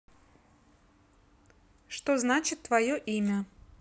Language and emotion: Russian, neutral